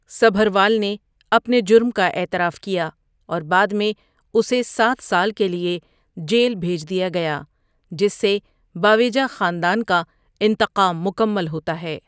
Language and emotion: Urdu, neutral